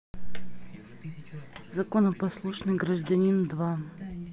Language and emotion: Russian, neutral